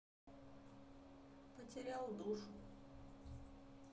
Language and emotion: Russian, sad